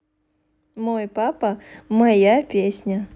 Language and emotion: Russian, positive